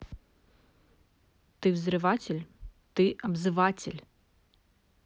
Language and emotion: Russian, neutral